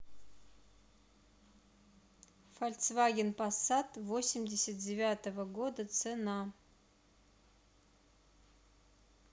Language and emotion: Russian, neutral